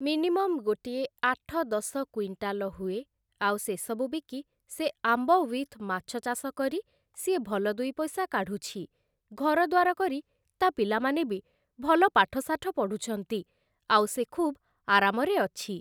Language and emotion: Odia, neutral